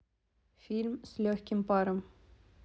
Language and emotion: Russian, neutral